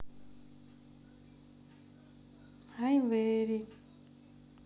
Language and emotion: Russian, neutral